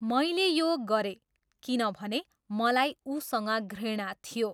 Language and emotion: Nepali, neutral